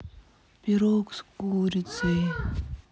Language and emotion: Russian, sad